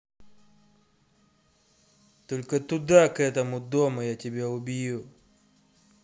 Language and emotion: Russian, angry